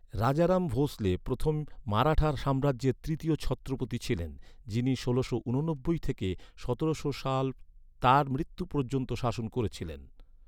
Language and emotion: Bengali, neutral